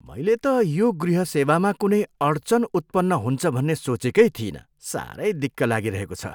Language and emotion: Nepali, disgusted